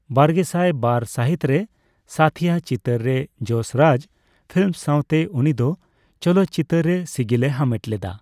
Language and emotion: Santali, neutral